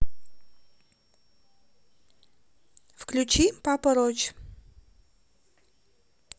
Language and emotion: Russian, neutral